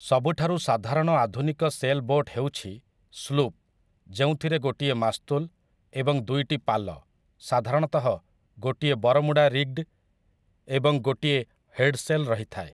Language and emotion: Odia, neutral